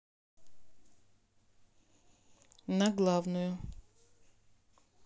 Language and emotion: Russian, neutral